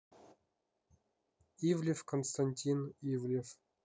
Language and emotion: Russian, neutral